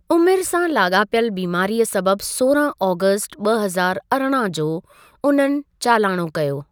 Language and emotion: Sindhi, neutral